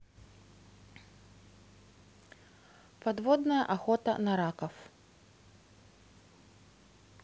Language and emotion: Russian, neutral